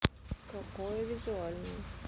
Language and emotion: Russian, neutral